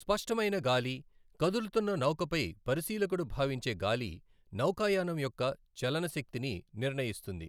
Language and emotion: Telugu, neutral